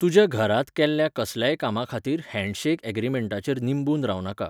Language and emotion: Goan Konkani, neutral